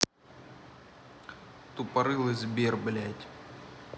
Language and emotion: Russian, angry